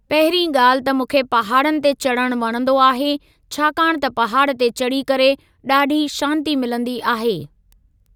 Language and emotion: Sindhi, neutral